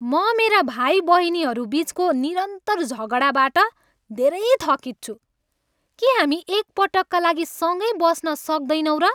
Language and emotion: Nepali, angry